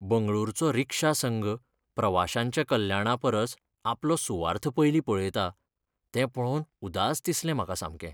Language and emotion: Goan Konkani, sad